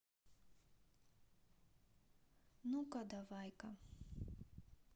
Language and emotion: Russian, neutral